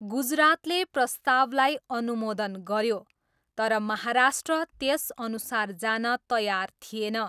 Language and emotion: Nepali, neutral